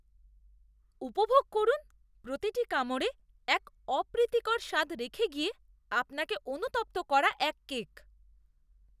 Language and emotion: Bengali, disgusted